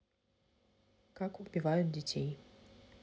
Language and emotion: Russian, neutral